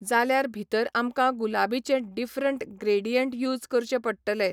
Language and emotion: Goan Konkani, neutral